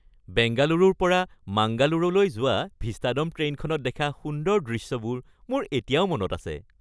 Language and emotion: Assamese, happy